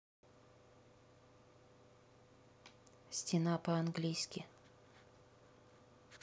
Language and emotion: Russian, neutral